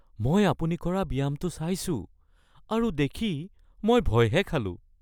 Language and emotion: Assamese, fearful